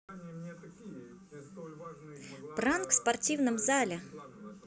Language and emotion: Russian, positive